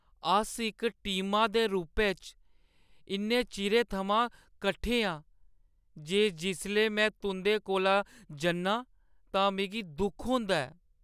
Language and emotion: Dogri, sad